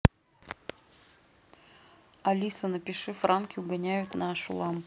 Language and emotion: Russian, neutral